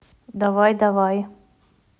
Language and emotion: Russian, neutral